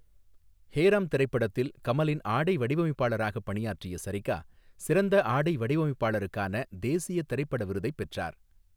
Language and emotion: Tamil, neutral